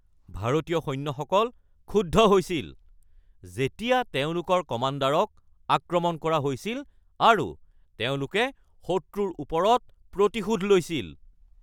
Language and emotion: Assamese, angry